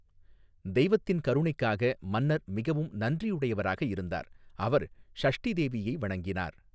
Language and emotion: Tamil, neutral